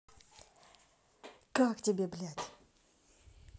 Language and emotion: Russian, angry